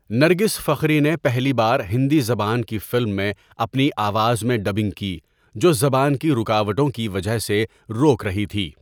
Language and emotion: Urdu, neutral